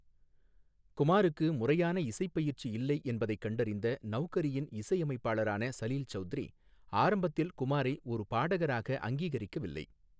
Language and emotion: Tamil, neutral